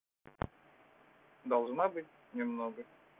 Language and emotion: Russian, neutral